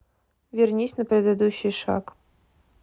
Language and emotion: Russian, neutral